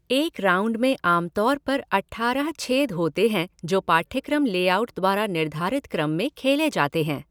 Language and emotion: Hindi, neutral